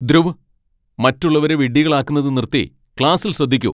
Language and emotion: Malayalam, angry